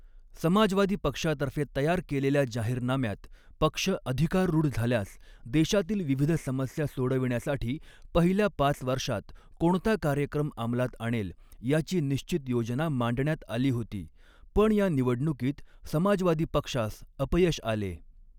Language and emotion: Marathi, neutral